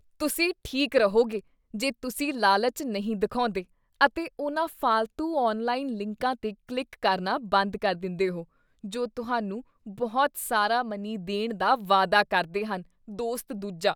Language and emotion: Punjabi, disgusted